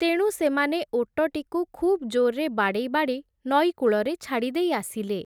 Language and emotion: Odia, neutral